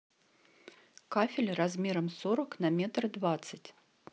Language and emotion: Russian, neutral